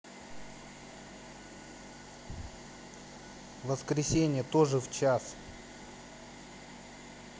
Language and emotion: Russian, angry